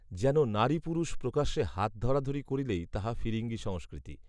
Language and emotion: Bengali, neutral